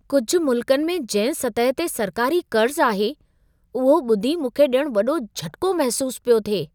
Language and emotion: Sindhi, surprised